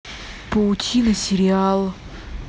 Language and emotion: Russian, neutral